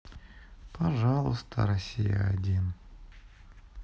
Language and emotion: Russian, sad